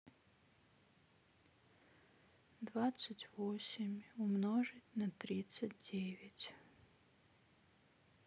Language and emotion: Russian, sad